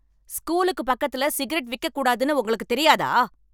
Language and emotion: Tamil, angry